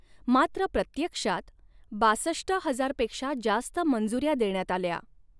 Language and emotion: Marathi, neutral